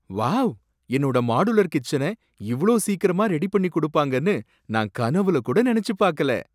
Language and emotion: Tamil, surprised